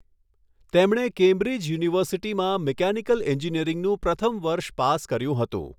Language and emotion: Gujarati, neutral